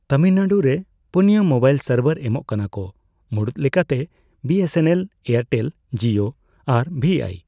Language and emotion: Santali, neutral